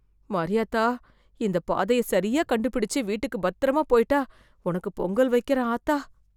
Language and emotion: Tamil, fearful